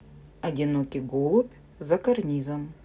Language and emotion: Russian, neutral